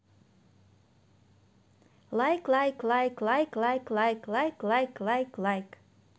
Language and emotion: Russian, positive